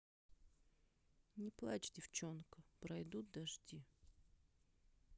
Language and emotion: Russian, sad